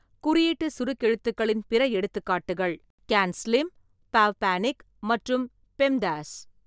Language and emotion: Tamil, neutral